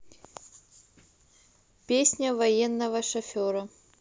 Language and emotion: Russian, neutral